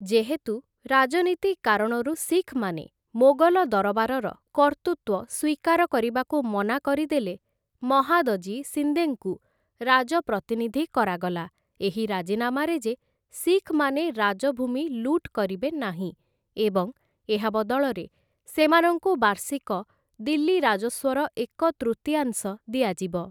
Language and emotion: Odia, neutral